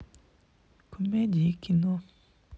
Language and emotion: Russian, sad